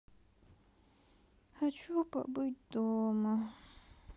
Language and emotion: Russian, sad